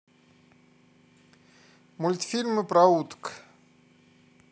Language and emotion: Russian, neutral